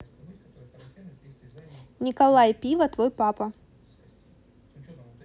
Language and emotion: Russian, neutral